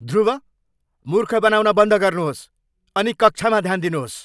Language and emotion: Nepali, angry